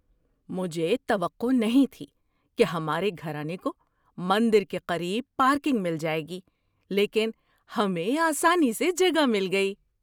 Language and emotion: Urdu, surprised